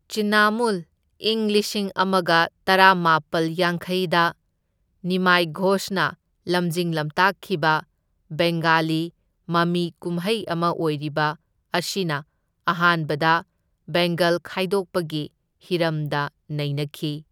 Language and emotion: Manipuri, neutral